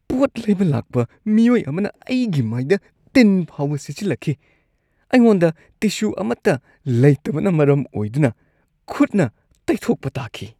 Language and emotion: Manipuri, disgusted